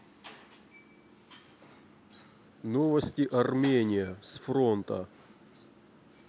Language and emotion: Russian, neutral